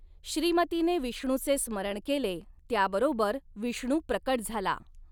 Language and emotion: Marathi, neutral